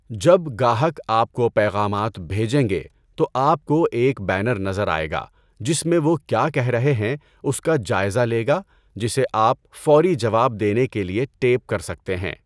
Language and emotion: Urdu, neutral